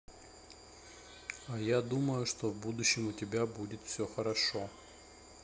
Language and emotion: Russian, neutral